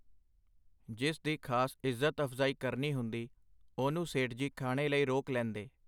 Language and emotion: Punjabi, neutral